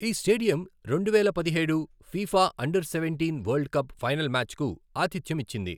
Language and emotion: Telugu, neutral